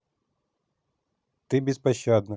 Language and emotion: Russian, neutral